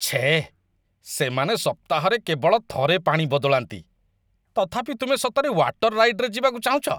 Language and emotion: Odia, disgusted